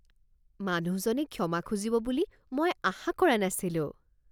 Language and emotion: Assamese, surprised